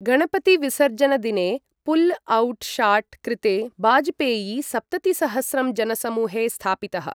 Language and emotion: Sanskrit, neutral